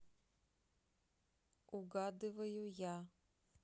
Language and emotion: Russian, neutral